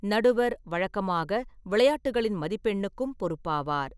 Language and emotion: Tamil, neutral